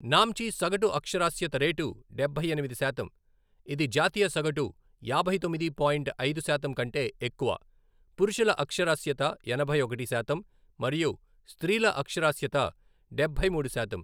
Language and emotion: Telugu, neutral